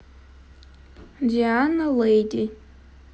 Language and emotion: Russian, neutral